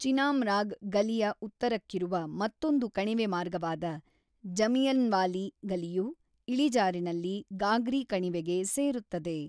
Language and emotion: Kannada, neutral